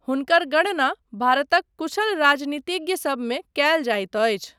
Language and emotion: Maithili, neutral